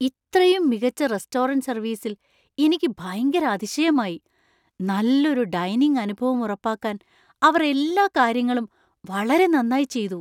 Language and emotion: Malayalam, surprised